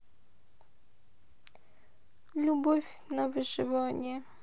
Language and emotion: Russian, sad